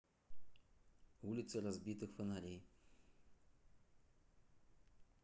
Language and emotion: Russian, neutral